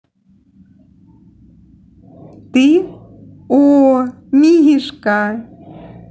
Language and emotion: Russian, positive